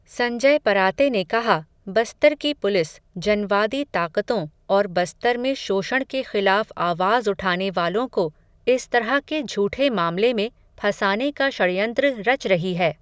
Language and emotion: Hindi, neutral